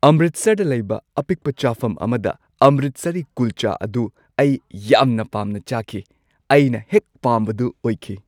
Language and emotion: Manipuri, happy